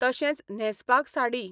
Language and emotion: Goan Konkani, neutral